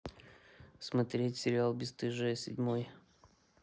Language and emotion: Russian, neutral